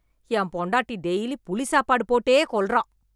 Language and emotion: Tamil, angry